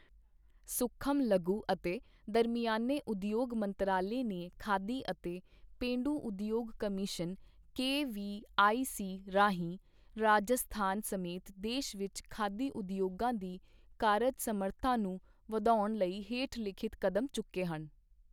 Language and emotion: Punjabi, neutral